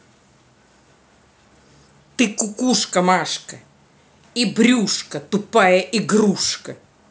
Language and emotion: Russian, angry